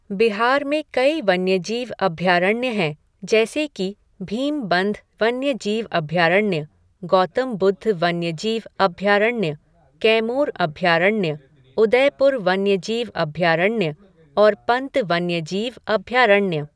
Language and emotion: Hindi, neutral